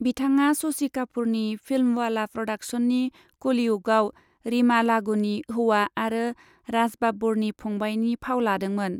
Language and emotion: Bodo, neutral